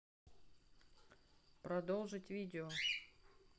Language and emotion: Russian, neutral